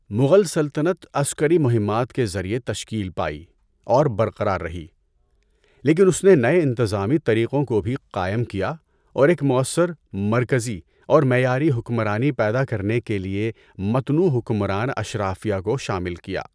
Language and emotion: Urdu, neutral